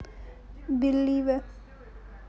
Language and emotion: Russian, neutral